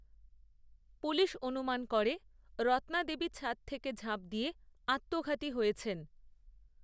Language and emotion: Bengali, neutral